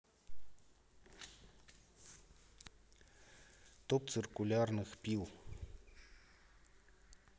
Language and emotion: Russian, neutral